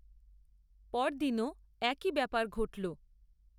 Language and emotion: Bengali, neutral